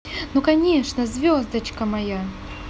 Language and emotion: Russian, positive